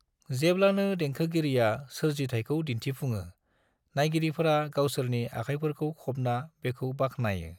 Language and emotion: Bodo, neutral